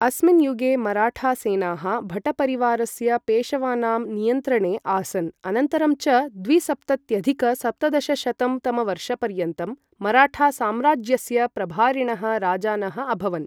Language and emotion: Sanskrit, neutral